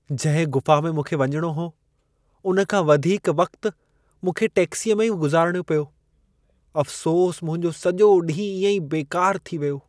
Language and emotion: Sindhi, sad